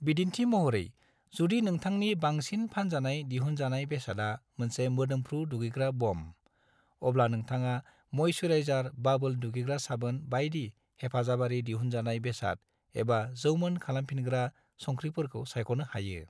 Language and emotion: Bodo, neutral